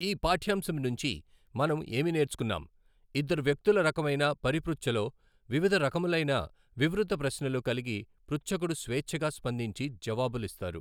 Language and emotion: Telugu, neutral